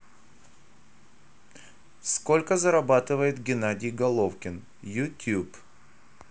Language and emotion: Russian, neutral